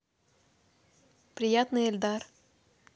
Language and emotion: Russian, neutral